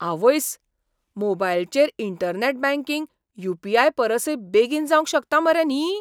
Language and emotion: Goan Konkani, surprised